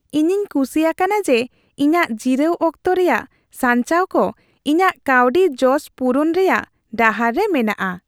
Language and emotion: Santali, happy